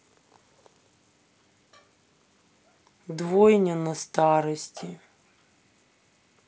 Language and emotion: Russian, sad